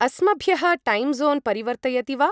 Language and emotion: Sanskrit, neutral